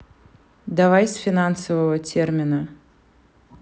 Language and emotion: Russian, neutral